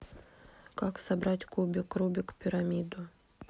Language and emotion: Russian, neutral